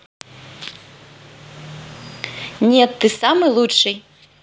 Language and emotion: Russian, positive